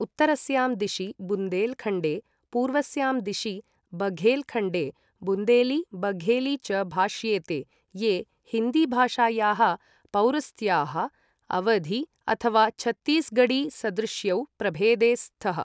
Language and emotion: Sanskrit, neutral